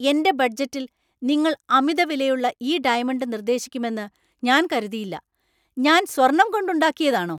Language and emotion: Malayalam, angry